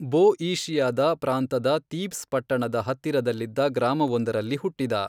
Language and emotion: Kannada, neutral